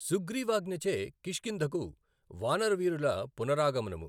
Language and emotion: Telugu, neutral